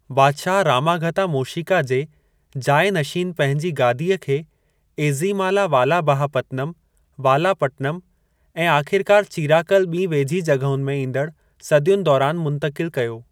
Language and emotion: Sindhi, neutral